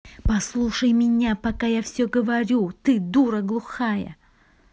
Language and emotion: Russian, angry